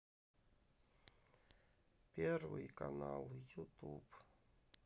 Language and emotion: Russian, sad